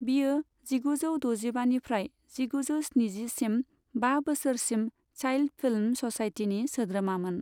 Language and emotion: Bodo, neutral